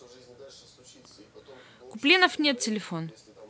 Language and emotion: Russian, neutral